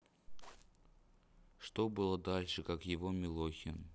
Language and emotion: Russian, neutral